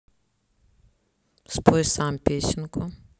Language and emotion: Russian, neutral